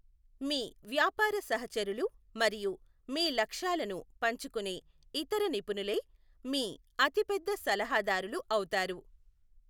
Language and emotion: Telugu, neutral